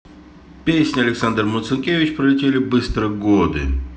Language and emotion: Russian, neutral